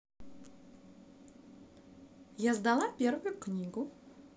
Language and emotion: Russian, positive